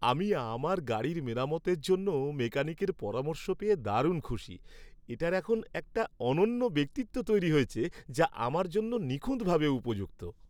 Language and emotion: Bengali, happy